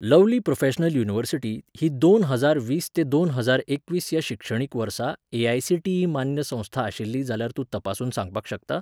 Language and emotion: Goan Konkani, neutral